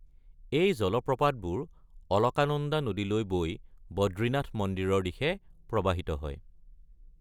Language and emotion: Assamese, neutral